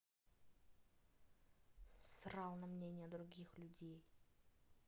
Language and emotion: Russian, angry